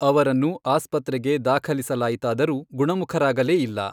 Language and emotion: Kannada, neutral